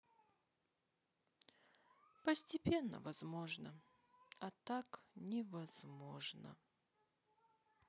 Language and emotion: Russian, sad